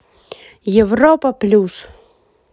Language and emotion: Russian, positive